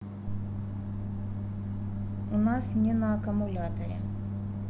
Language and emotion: Russian, neutral